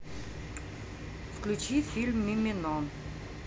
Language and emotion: Russian, neutral